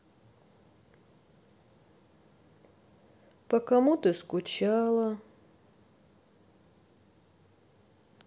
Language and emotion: Russian, sad